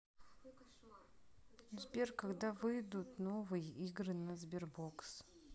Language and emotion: Russian, neutral